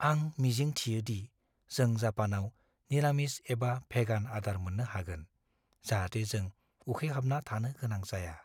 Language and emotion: Bodo, fearful